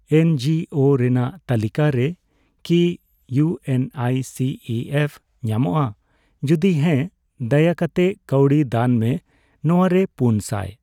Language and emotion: Santali, neutral